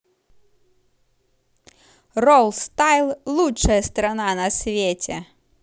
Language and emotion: Russian, positive